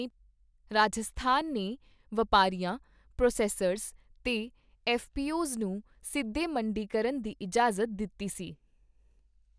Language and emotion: Punjabi, neutral